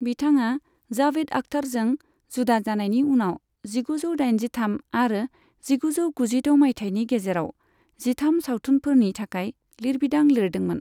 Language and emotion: Bodo, neutral